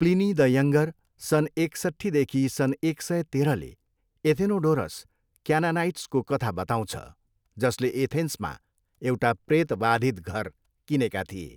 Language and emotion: Nepali, neutral